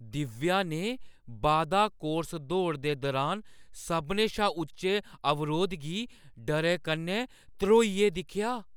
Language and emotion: Dogri, fearful